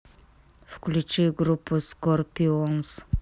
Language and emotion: Russian, neutral